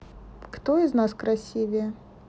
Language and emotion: Russian, neutral